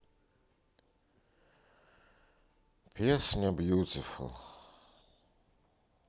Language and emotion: Russian, sad